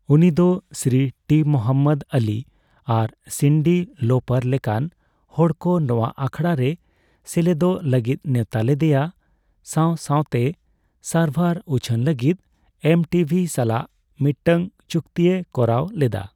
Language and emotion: Santali, neutral